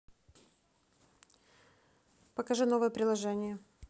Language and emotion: Russian, neutral